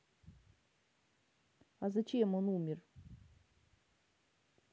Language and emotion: Russian, neutral